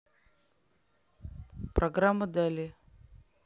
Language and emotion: Russian, neutral